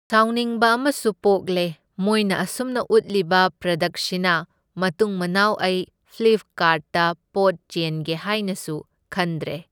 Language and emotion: Manipuri, neutral